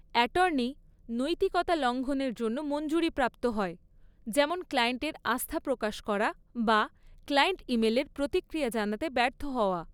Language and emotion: Bengali, neutral